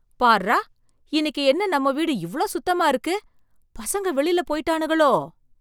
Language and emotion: Tamil, surprised